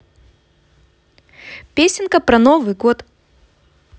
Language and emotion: Russian, positive